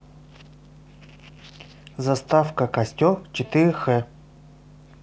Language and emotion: Russian, neutral